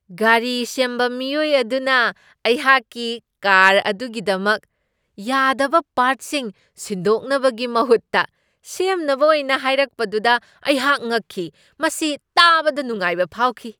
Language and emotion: Manipuri, surprised